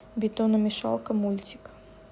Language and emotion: Russian, neutral